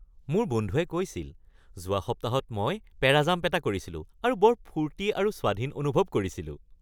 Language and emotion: Assamese, happy